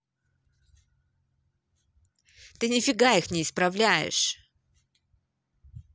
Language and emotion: Russian, angry